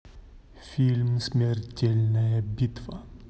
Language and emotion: Russian, neutral